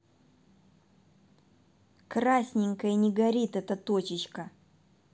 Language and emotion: Russian, angry